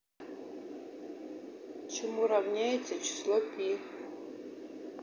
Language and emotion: Russian, neutral